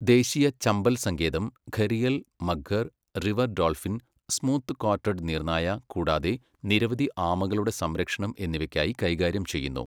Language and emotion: Malayalam, neutral